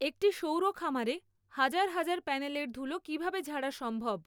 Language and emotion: Bengali, neutral